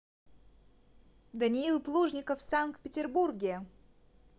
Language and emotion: Russian, positive